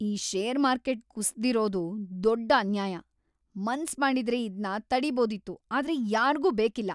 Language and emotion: Kannada, angry